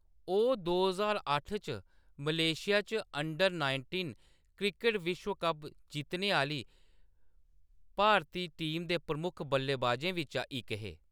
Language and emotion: Dogri, neutral